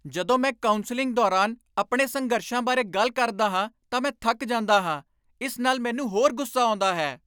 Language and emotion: Punjabi, angry